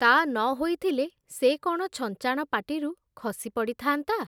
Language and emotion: Odia, neutral